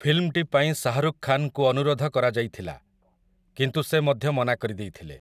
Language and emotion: Odia, neutral